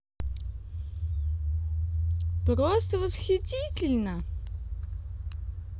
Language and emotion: Russian, positive